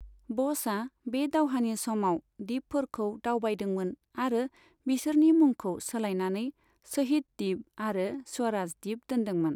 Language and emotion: Bodo, neutral